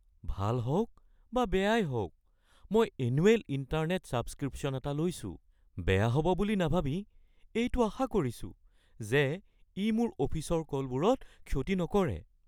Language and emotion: Assamese, fearful